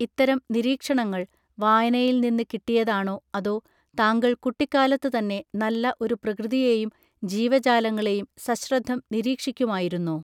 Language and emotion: Malayalam, neutral